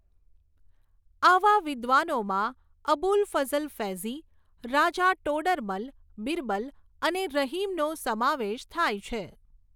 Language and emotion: Gujarati, neutral